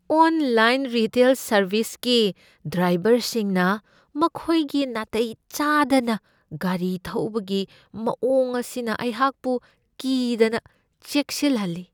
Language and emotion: Manipuri, fearful